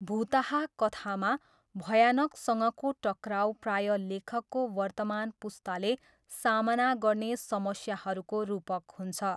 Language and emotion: Nepali, neutral